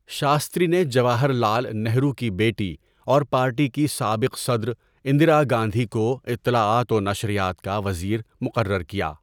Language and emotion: Urdu, neutral